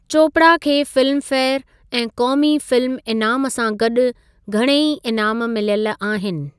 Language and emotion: Sindhi, neutral